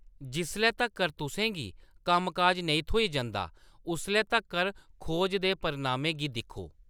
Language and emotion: Dogri, neutral